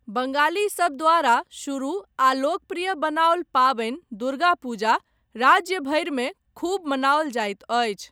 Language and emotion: Maithili, neutral